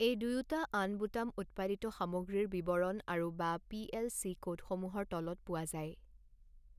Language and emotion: Assamese, neutral